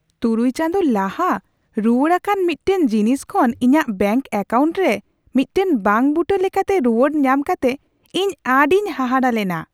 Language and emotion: Santali, surprised